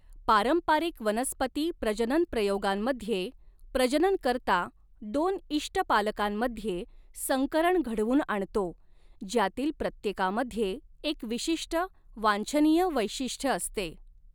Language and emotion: Marathi, neutral